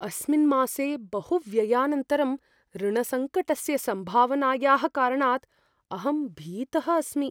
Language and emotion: Sanskrit, fearful